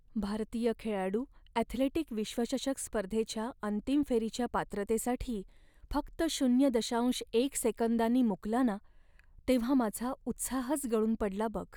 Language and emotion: Marathi, sad